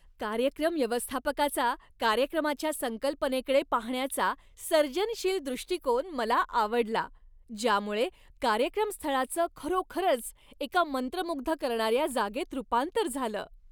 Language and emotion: Marathi, happy